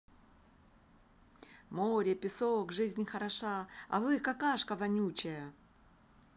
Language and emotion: Russian, positive